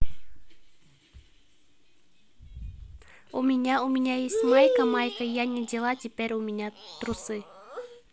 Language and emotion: Russian, positive